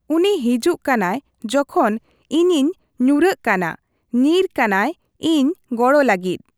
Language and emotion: Santali, neutral